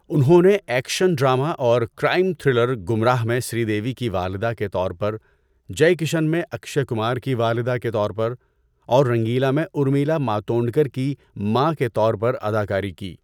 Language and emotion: Urdu, neutral